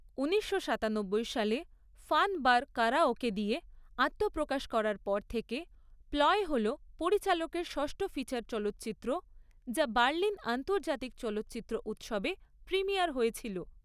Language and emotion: Bengali, neutral